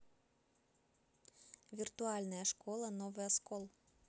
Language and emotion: Russian, neutral